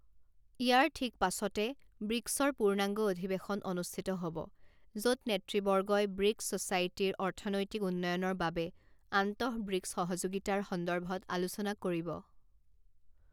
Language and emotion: Assamese, neutral